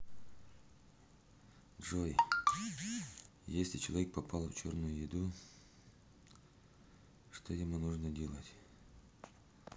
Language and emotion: Russian, neutral